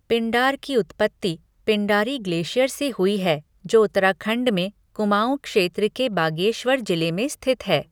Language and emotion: Hindi, neutral